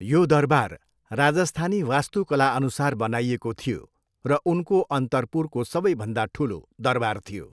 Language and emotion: Nepali, neutral